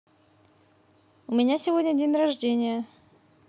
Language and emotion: Russian, positive